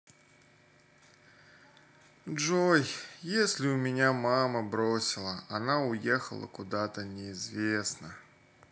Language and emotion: Russian, sad